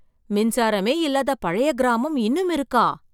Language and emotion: Tamil, surprised